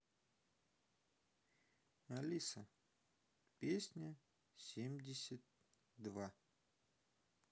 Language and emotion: Russian, neutral